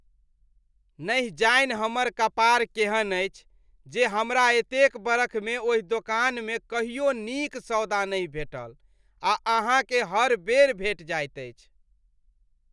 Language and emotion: Maithili, disgusted